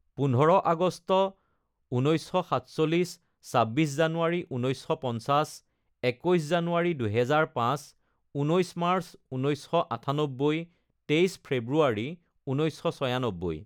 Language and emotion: Assamese, neutral